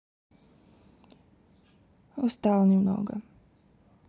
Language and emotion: Russian, sad